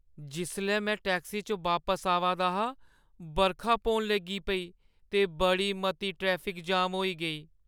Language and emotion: Dogri, sad